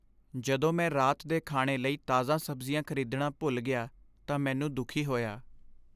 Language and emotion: Punjabi, sad